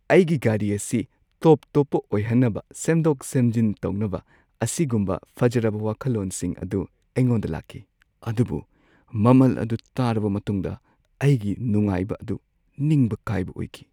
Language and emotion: Manipuri, sad